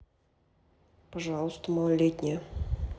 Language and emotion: Russian, neutral